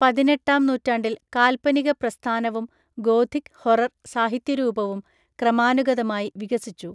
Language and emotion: Malayalam, neutral